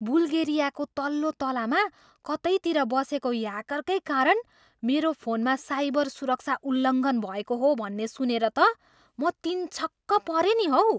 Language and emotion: Nepali, surprised